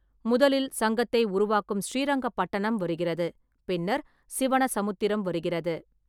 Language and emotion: Tamil, neutral